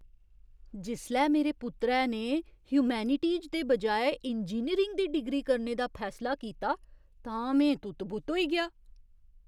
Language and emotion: Dogri, surprised